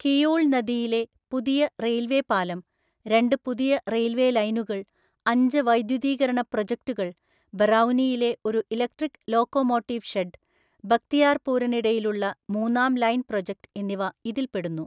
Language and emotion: Malayalam, neutral